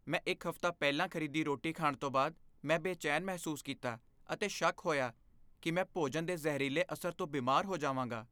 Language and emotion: Punjabi, fearful